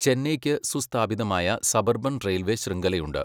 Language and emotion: Malayalam, neutral